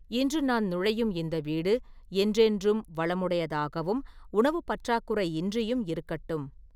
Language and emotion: Tamil, neutral